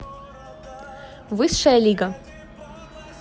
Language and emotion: Russian, positive